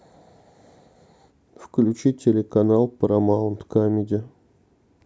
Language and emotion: Russian, neutral